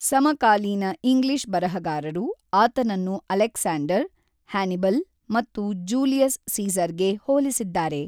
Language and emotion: Kannada, neutral